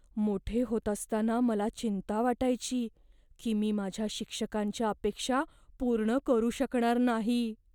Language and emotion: Marathi, fearful